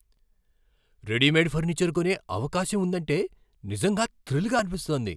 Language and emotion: Telugu, surprised